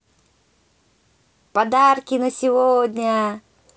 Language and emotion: Russian, positive